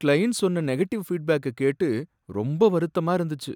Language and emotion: Tamil, sad